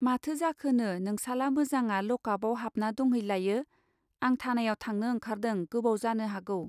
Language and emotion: Bodo, neutral